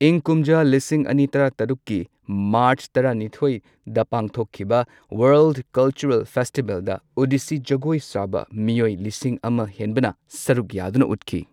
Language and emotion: Manipuri, neutral